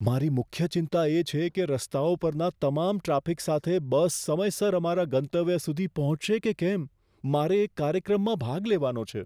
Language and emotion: Gujarati, fearful